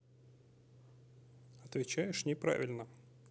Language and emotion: Russian, neutral